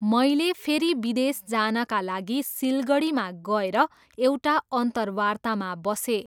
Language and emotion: Nepali, neutral